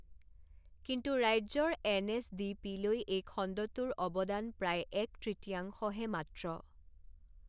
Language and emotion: Assamese, neutral